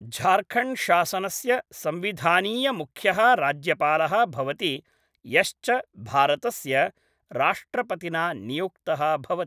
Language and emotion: Sanskrit, neutral